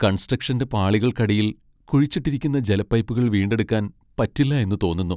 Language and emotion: Malayalam, sad